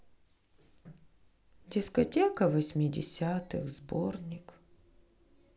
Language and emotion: Russian, sad